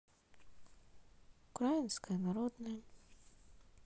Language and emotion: Russian, sad